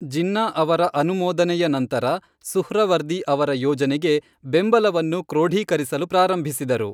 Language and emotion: Kannada, neutral